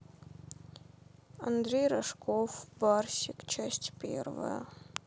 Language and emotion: Russian, sad